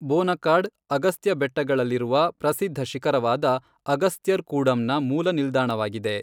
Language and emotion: Kannada, neutral